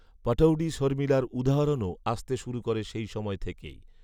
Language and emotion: Bengali, neutral